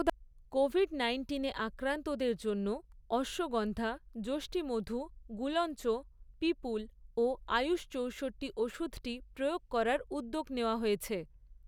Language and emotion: Bengali, neutral